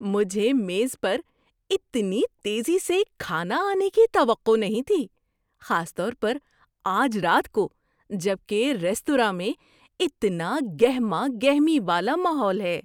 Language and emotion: Urdu, surprised